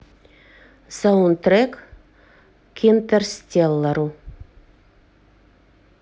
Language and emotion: Russian, neutral